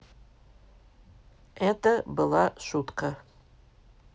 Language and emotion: Russian, neutral